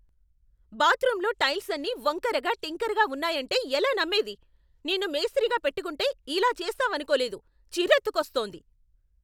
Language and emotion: Telugu, angry